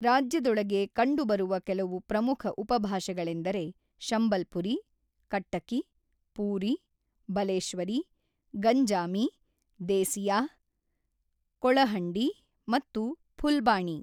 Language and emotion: Kannada, neutral